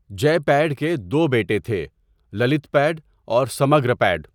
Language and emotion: Urdu, neutral